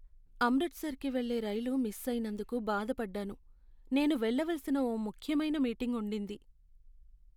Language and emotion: Telugu, sad